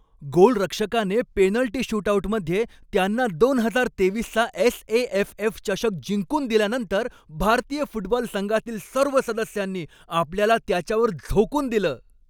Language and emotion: Marathi, happy